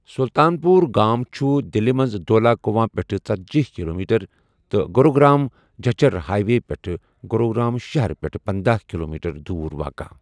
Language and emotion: Kashmiri, neutral